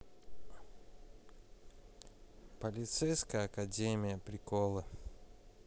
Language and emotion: Russian, neutral